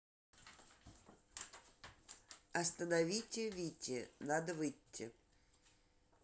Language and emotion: Russian, neutral